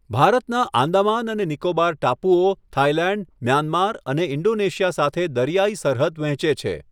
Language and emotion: Gujarati, neutral